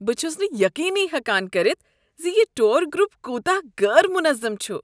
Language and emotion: Kashmiri, disgusted